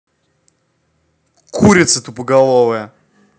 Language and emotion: Russian, angry